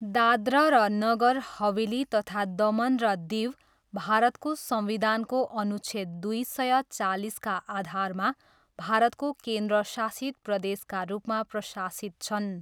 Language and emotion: Nepali, neutral